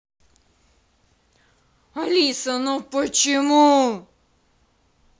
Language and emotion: Russian, angry